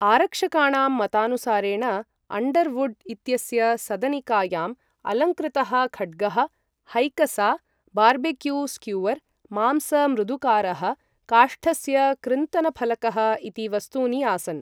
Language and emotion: Sanskrit, neutral